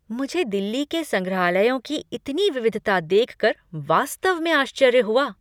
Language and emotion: Hindi, surprised